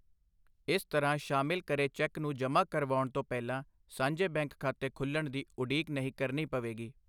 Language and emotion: Punjabi, neutral